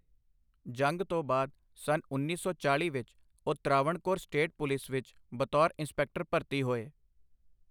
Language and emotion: Punjabi, neutral